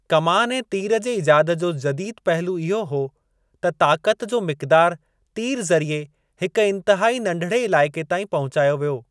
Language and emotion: Sindhi, neutral